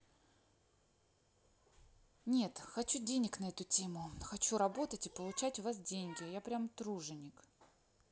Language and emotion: Russian, neutral